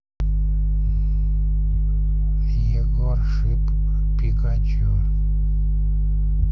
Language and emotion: Russian, neutral